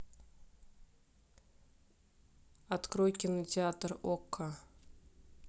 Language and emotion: Russian, neutral